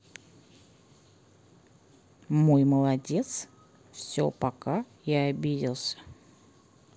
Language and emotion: Russian, neutral